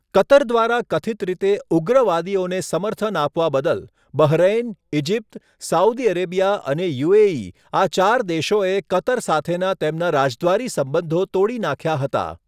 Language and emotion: Gujarati, neutral